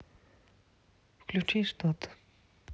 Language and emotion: Russian, neutral